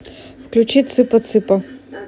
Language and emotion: Russian, neutral